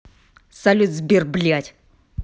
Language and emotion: Russian, angry